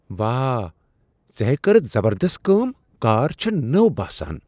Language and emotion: Kashmiri, surprised